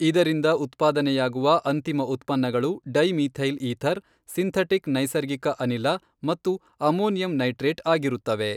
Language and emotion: Kannada, neutral